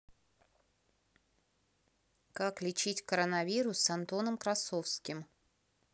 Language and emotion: Russian, neutral